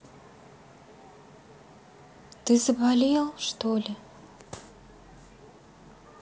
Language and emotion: Russian, sad